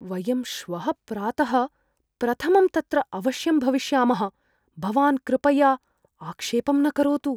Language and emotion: Sanskrit, fearful